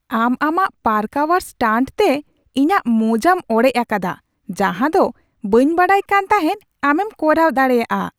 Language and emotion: Santali, surprised